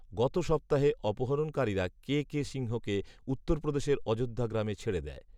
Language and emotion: Bengali, neutral